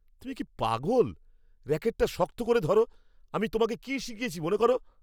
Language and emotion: Bengali, angry